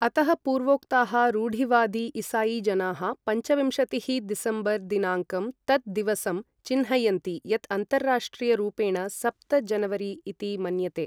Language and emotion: Sanskrit, neutral